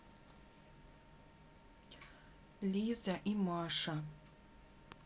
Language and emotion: Russian, neutral